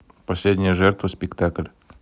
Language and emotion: Russian, neutral